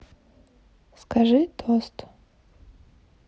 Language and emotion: Russian, neutral